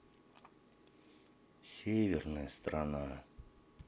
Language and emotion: Russian, sad